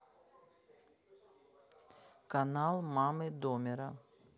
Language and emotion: Russian, neutral